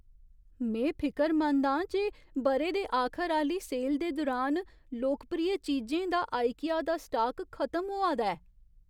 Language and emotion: Dogri, fearful